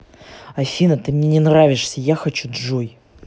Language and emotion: Russian, angry